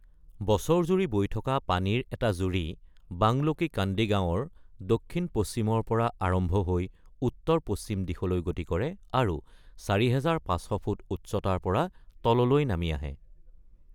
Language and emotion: Assamese, neutral